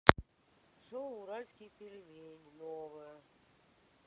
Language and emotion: Russian, neutral